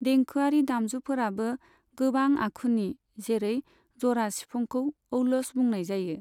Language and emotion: Bodo, neutral